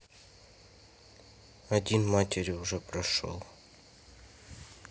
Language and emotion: Russian, neutral